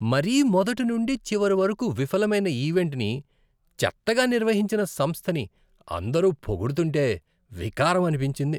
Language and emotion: Telugu, disgusted